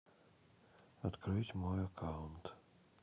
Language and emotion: Russian, neutral